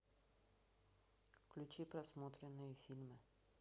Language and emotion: Russian, neutral